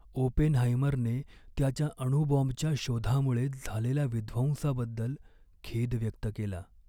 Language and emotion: Marathi, sad